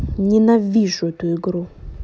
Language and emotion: Russian, angry